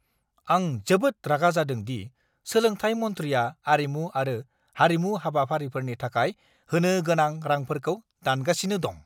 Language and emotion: Bodo, angry